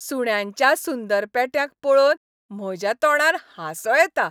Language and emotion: Goan Konkani, happy